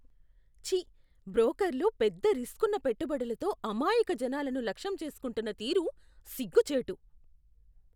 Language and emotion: Telugu, disgusted